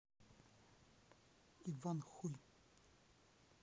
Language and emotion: Russian, neutral